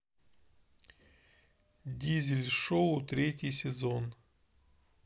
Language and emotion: Russian, neutral